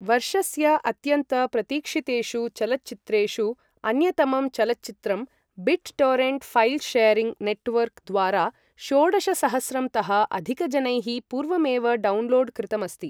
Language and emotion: Sanskrit, neutral